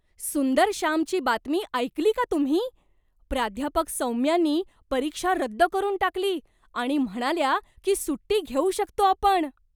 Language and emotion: Marathi, surprised